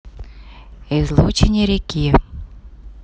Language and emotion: Russian, neutral